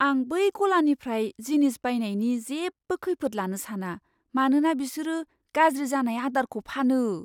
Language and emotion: Bodo, fearful